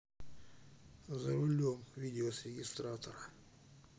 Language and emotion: Russian, neutral